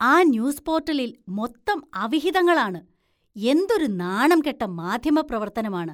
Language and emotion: Malayalam, disgusted